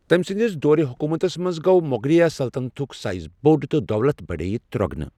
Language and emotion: Kashmiri, neutral